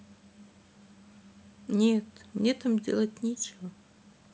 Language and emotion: Russian, sad